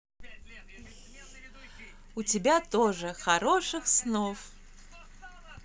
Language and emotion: Russian, positive